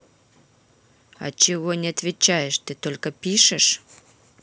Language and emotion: Russian, angry